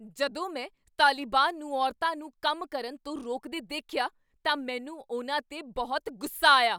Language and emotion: Punjabi, angry